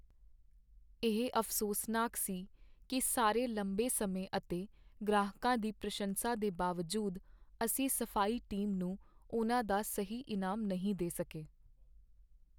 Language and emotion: Punjabi, sad